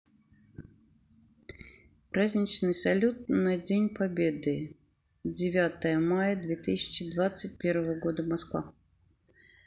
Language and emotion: Russian, neutral